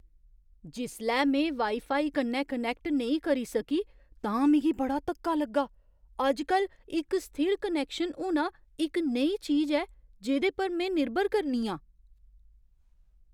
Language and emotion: Dogri, surprised